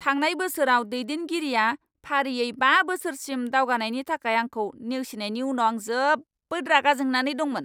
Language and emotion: Bodo, angry